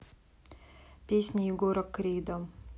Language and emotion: Russian, neutral